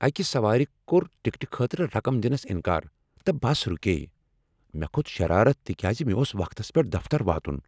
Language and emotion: Kashmiri, angry